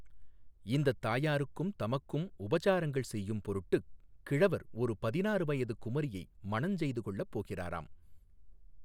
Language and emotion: Tamil, neutral